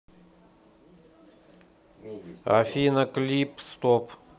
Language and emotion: Russian, neutral